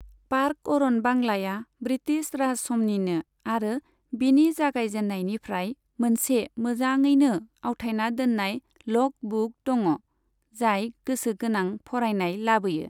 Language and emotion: Bodo, neutral